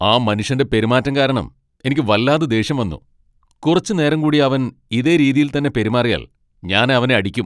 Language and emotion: Malayalam, angry